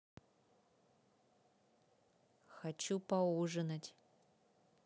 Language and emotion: Russian, neutral